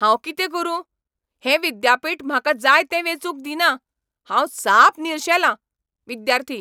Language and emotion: Goan Konkani, angry